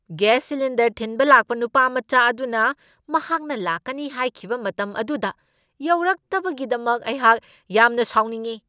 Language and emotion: Manipuri, angry